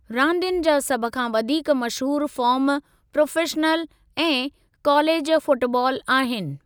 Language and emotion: Sindhi, neutral